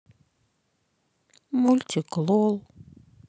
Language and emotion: Russian, sad